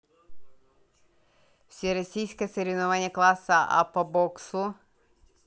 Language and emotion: Russian, neutral